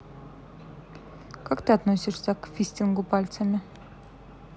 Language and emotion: Russian, neutral